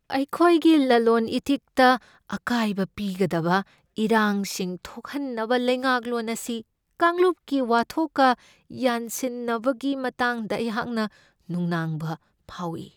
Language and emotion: Manipuri, fearful